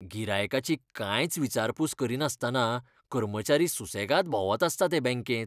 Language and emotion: Goan Konkani, disgusted